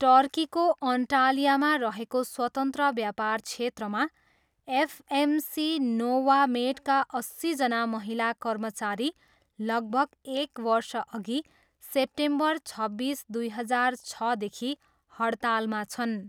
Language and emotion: Nepali, neutral